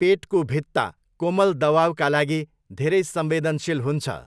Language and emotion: Nepali, neutral